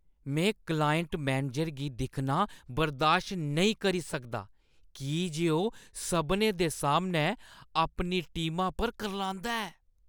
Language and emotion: Dogri, disgusted